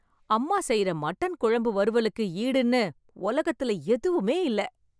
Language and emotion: Tamil, happy